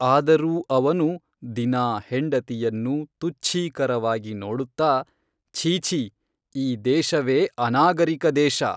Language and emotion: Kannada, neutral